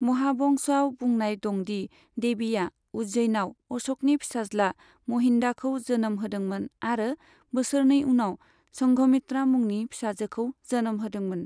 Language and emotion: Bodo, neutral